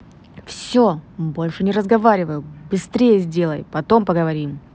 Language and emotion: Russian, angry